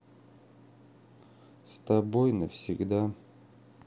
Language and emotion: Russian, sad